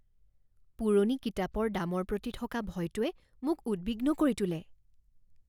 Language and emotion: Assamese, fearful